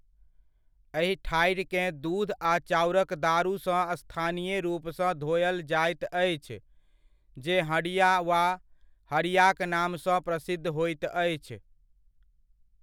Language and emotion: Maithili, neutral